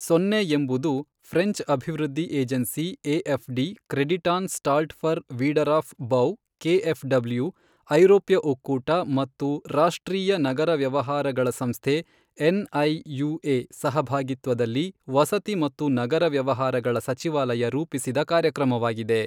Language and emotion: Kannada, neutral